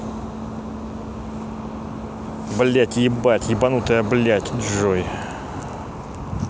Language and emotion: Russian, angry